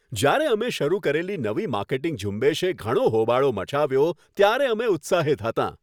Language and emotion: Gujarati, happy